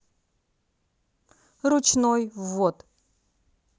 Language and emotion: Russian, neutral